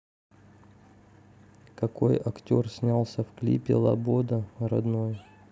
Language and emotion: Russian, neutral